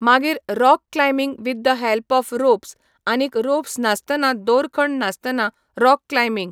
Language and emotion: Goan Konkani, neutral